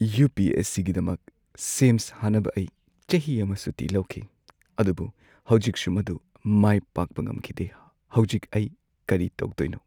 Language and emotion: Manipuri, sad